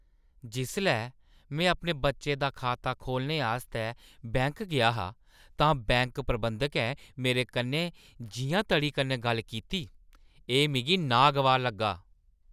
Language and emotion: Dogri, disgusted